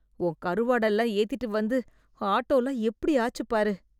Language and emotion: Tamil, disgusted